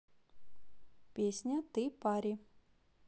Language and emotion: Russian, neutral